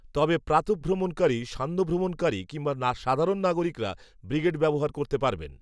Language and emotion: Bengali, neutral